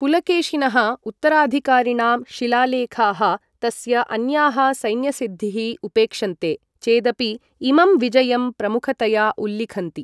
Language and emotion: Sanskrit, neutral